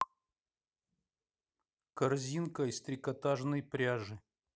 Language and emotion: Russian, neutral